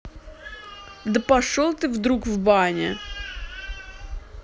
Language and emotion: Russian, angry